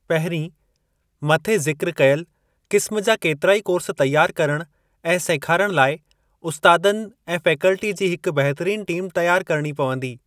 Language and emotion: Sindhi, neutral